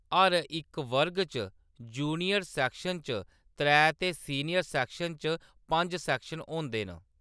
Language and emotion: Dogri, neutral